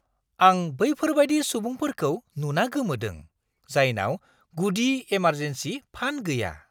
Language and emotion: Bodo, surprised